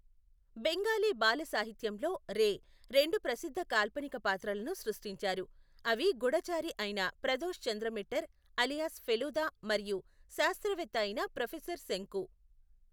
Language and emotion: Telugu, neutral